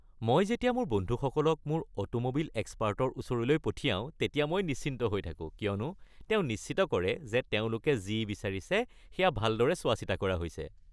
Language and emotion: Assamese, happy